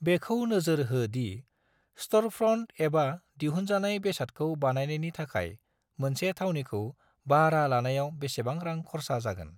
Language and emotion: Bodo, neutral